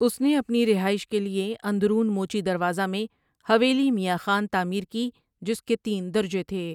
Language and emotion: Urdu, neutral